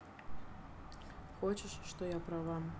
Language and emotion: Russian, neutral